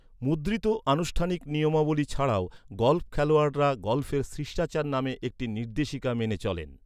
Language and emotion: Bengali, neutral